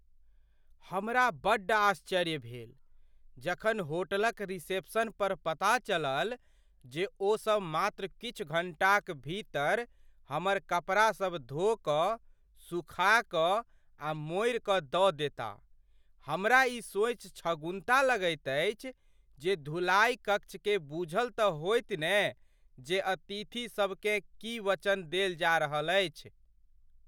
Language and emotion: Maithili, surprised